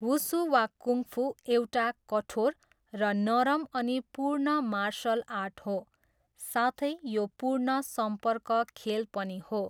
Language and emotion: Nepali, neutral